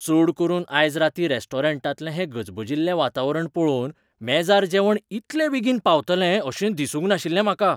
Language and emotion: Goan Konkani, surprised